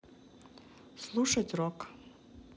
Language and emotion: Russian, neutral